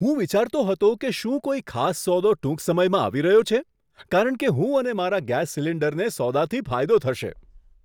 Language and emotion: Gujarati, surprised